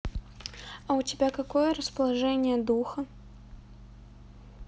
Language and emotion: Russian, neutral